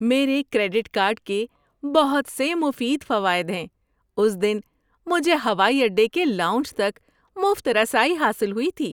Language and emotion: Urdu, happy